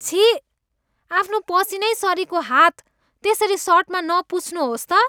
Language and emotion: Nepali, disgusted